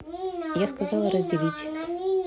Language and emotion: Russian, neutral